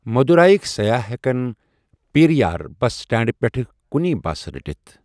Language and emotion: Kashmiri, neutral